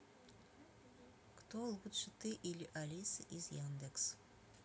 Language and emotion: Russian, neutral